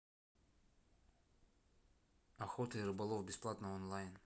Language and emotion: Russian, neutral